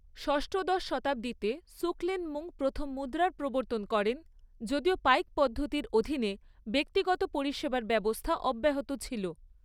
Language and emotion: Bengali, neutral